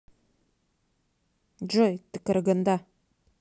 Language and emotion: Russian, neutral